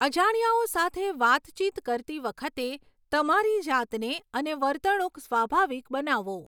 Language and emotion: Gujarati, neutral